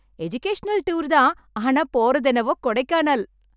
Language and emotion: Tamil, happy